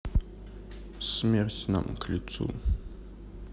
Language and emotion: Russian, sad